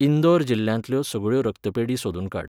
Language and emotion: Goan Konkani, neutral